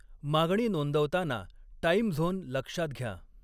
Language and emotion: Marathi, neutral